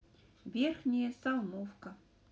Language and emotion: Russian, neutral